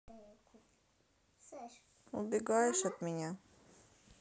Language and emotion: Russian, sad